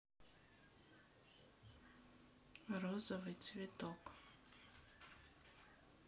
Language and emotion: Russian, sad